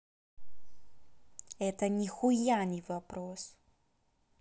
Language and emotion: Russian, angry